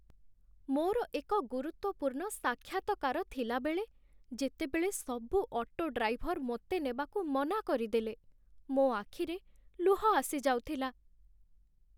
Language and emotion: Odia, sad